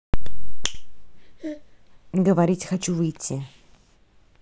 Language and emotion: Russian, neutral